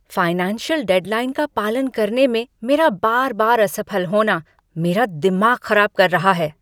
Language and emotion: Hindi, angry